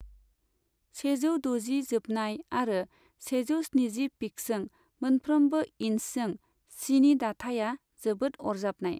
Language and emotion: Bodo, neutral